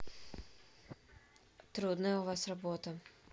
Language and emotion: Russian, neutral